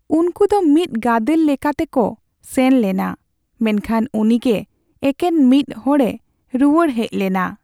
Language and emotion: Santali, sad